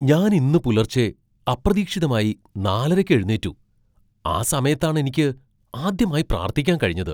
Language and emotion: Malayalam, surprised